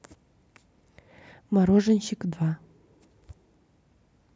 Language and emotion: Russian, neutral